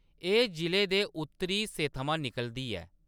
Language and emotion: Dogri, neutral